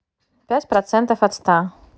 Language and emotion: Russian, neutral